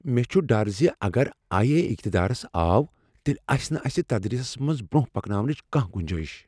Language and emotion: Kashmiri, fearful